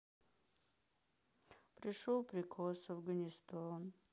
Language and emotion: Russian, sad